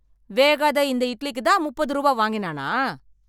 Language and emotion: Tamil, angry